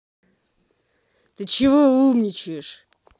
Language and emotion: Russian, angry